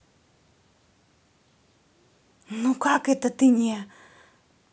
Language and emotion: Russian, angry